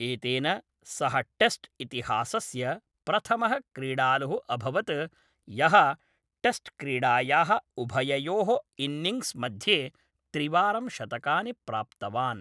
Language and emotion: Sanskrit, neutral